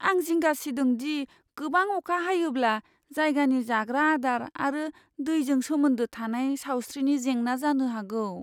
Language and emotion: Bodo, fearful